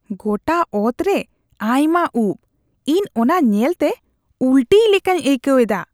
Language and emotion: Santali, disgusted